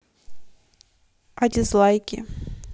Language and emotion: Russian, neutral